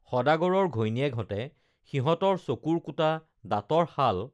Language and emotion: Assamese, neutral